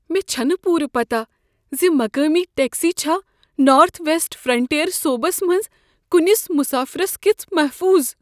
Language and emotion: Kashmiri, fearful